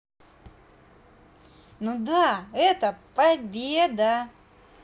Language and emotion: Russian, positive